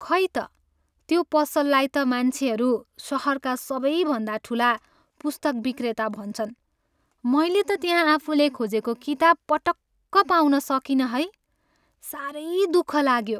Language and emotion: Nepali, sad